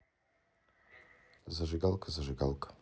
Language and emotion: Russian, neutral